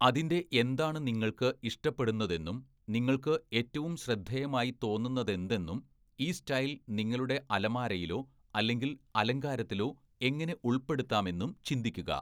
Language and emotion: Malayalam, neutral